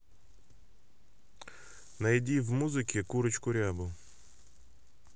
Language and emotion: Russian, neutral